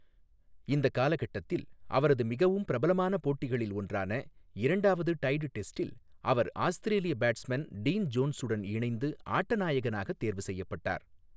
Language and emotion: Tamil, neutral